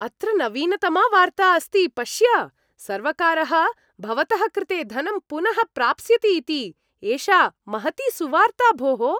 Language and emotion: Sanskrit, happy